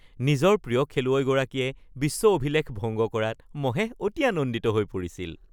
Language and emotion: Assamese, happy